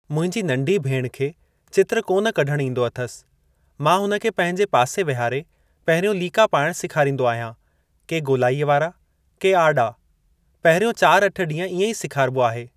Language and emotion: Sindhi, neutral